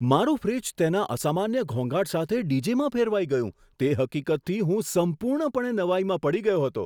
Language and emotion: Gujarati, surprised